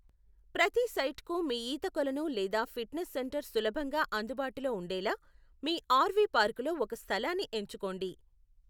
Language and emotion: Telugu, neutral